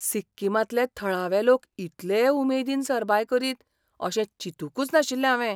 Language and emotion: Goan Konkani, surprised